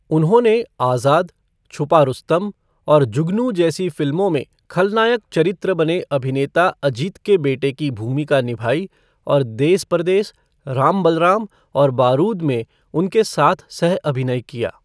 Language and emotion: Hindi, neutral